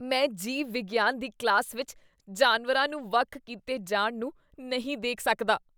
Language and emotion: Punjabi, disgusted